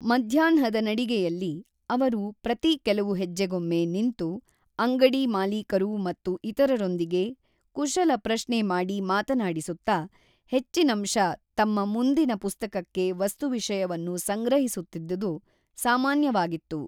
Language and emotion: Kannada, neutral